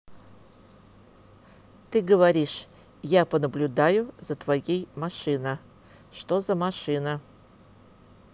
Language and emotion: Russian, neutral